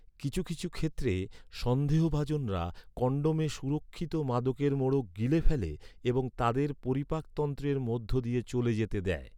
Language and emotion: Bengali, neutral